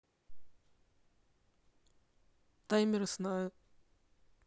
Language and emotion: Russian, neutral